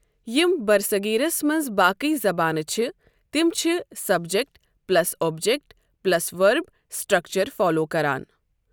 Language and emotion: Kashmiri, neutral